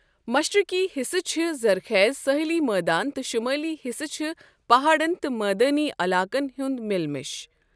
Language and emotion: Kashmiri, neutral